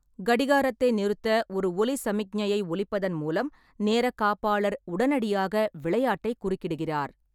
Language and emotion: Tamil, neutral